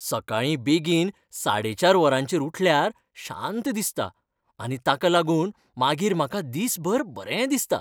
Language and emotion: Goan Konkani, happy